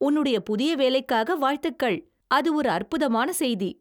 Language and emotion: Tamil, happy